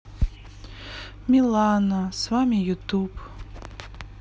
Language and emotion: Russian, sad